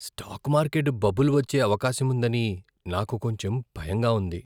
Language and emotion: Telugu, fearful